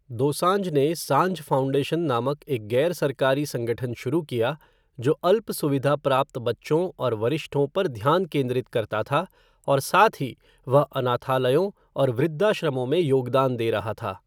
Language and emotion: Hindi, neutral